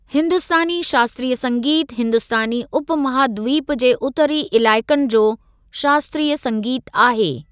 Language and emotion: Sindhi, neutral